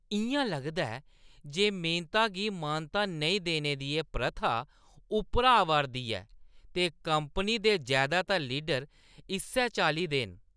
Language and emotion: Dogri, disgusted